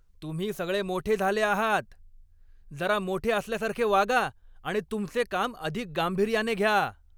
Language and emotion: Marathi, angry